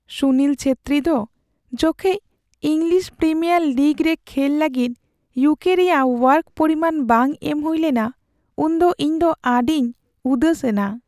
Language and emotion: Santali, sad